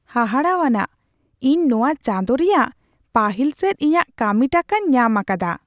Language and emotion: Santali, surprised